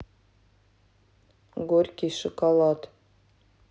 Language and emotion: Russian, neutral